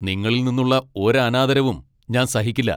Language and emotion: Malayalam, angry